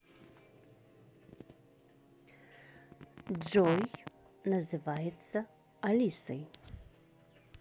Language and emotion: Russian, neutral